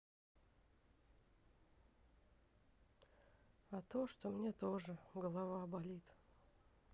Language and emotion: Russian, sad